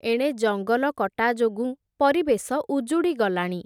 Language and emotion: Odia, neutral